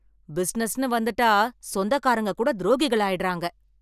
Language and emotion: Tamil, angry